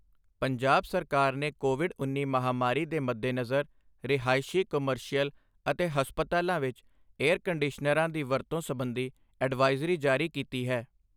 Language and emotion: Punjabi, neutral